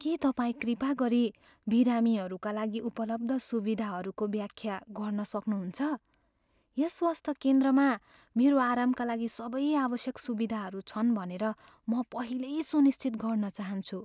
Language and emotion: Nepali, fearful